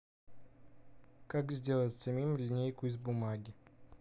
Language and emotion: Russian, neutral